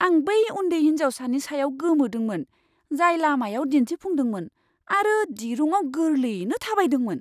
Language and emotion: Bodo, surprised